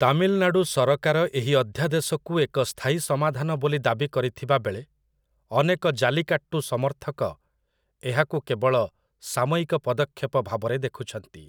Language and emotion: Odia, neutral